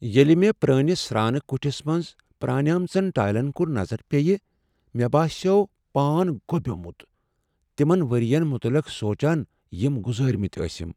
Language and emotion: Kashmiri, sad